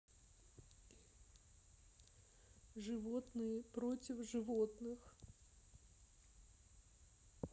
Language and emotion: Russian, sad